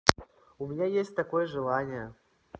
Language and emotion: Russian, neutral